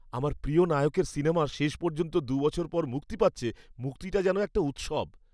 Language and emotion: Bengali, happy